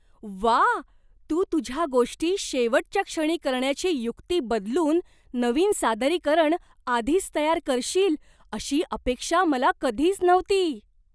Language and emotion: Marathi, surprised